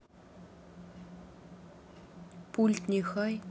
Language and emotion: Russian, neutral